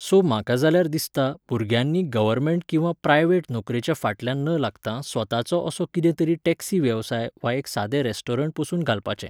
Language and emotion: Goan Konkani, neutral